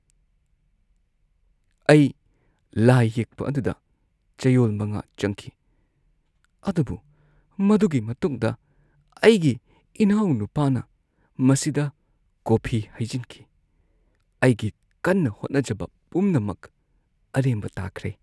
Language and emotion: Manipuri, sad